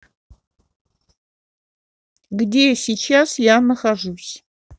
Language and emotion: Russian, neutral